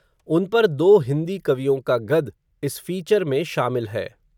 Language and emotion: Hindi, neutral